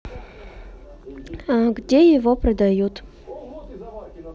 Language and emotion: Russian, neutral